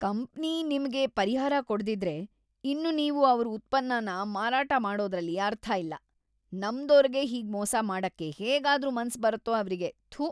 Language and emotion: Kannada, disgusted